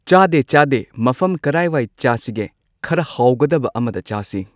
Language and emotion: Manipuri, neutral